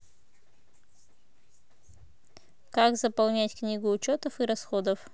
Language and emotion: Russian, neutral